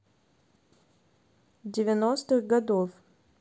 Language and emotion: Russian, neutral